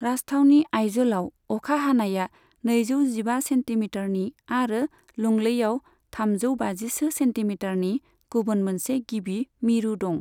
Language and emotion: Bodo, neutral